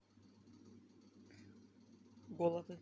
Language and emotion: Russian, neutral